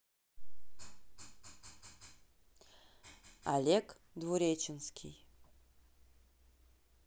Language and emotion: Russian, neutral